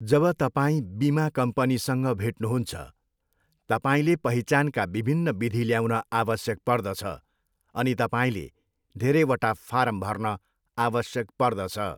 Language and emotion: Nepali, neutral